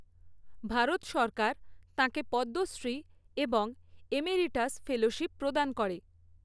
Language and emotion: Bengali, neutral